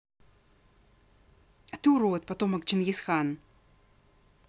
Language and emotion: Russian, angry